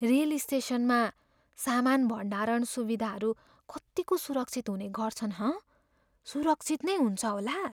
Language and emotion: Nepali, fearful